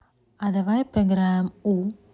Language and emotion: Russian, neutral